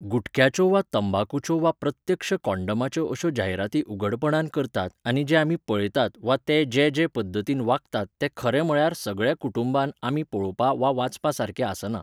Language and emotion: Goan Konkani, neutral